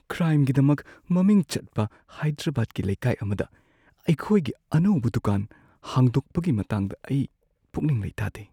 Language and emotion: Manipuri, fearful